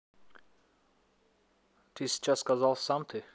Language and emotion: Russian, neutral